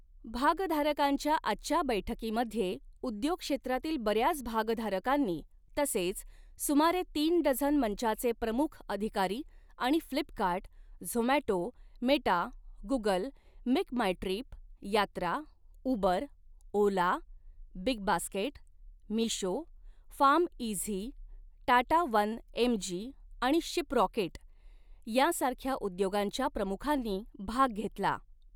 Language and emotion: Marathi, neutral